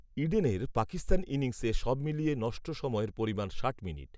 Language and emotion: Bengali, neutral